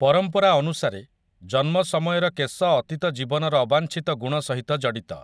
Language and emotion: Odia, neutral